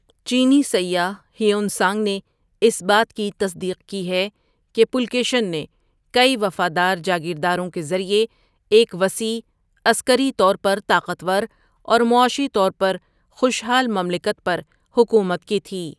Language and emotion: Urdu, neutral